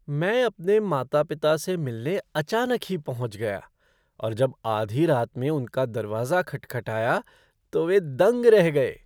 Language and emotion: Hindi, surprised